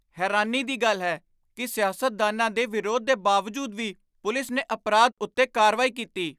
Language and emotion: Punjabi, surprised